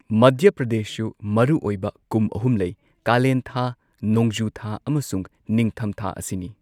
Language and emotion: Manipuri, neutral